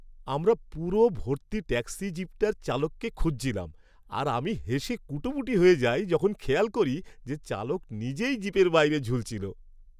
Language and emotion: Bengali, happy